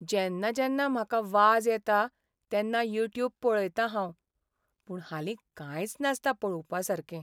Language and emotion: Goan Konkani, sad